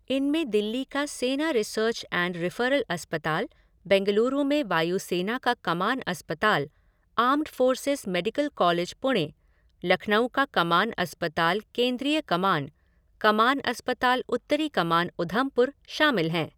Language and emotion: Hindi, neutral